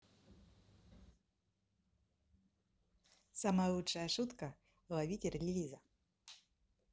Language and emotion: Russian, positive